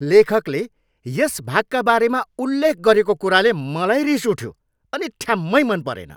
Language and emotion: Nepali, angry